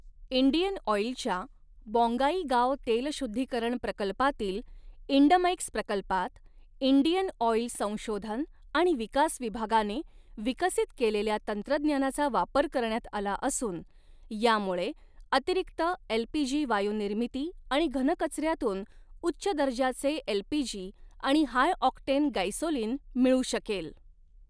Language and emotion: Marathi, neutral